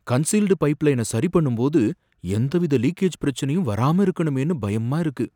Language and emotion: Tamil, fearful